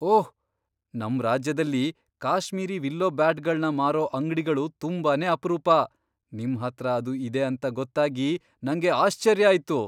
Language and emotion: Kannada, surprised